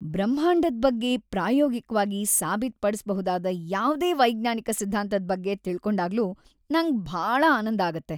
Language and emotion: Kannada, happy